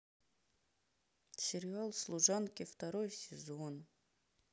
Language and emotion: Russian, sad